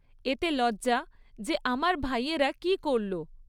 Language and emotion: Bengali, neutral